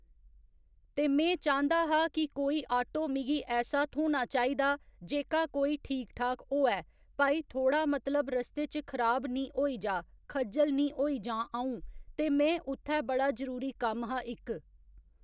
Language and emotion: Dogri, neutral